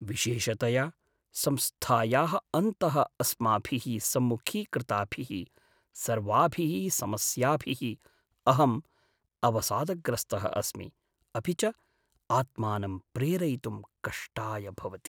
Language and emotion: Sanskrit, sad